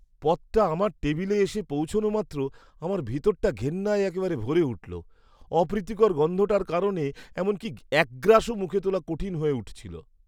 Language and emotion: Bengali, disgusted